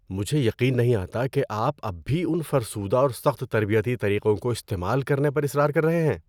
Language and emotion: Urdu, disgusted